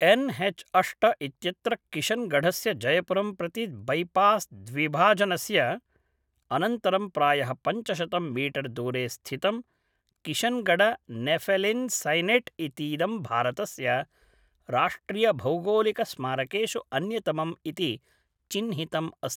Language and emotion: Sanskrit, neutral